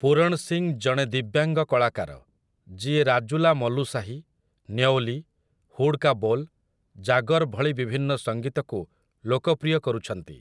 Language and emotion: Odia, neutral